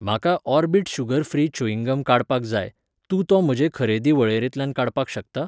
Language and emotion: Goan Konkani, neutral